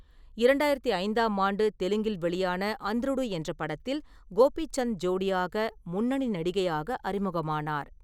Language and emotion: Tamil, neutral